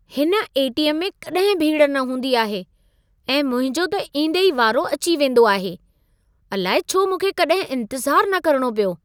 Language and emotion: Sindhi, surprised